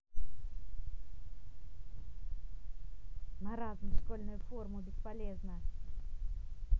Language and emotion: Russian, angry